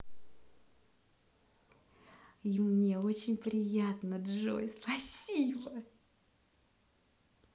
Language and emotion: Russian, positive